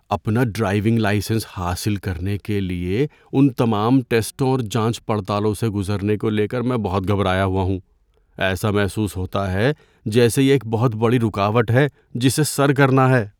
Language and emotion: Urdu, fearful